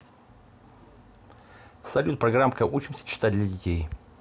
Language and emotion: Russian, neutral